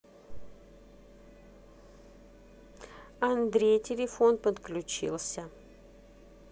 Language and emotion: Russian, neutral